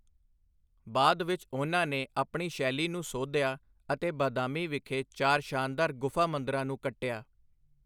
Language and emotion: Punjabi, neutral